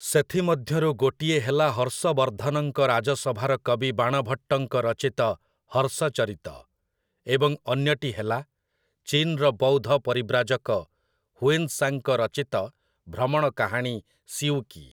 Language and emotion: Odia, neutral